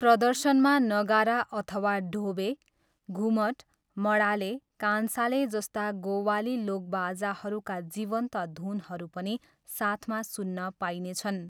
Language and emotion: Nepali, neutral